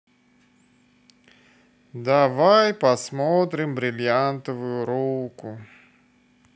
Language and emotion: Russian, neutral